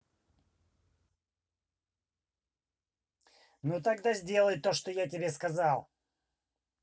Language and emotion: Russian, angry